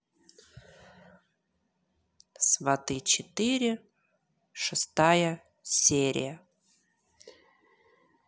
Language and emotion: Russian, neutral